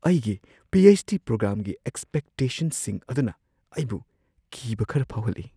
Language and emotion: Manipuri, fearful